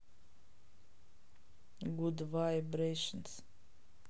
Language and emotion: Russian, neutral